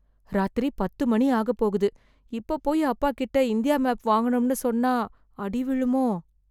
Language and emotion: Tamil, fearful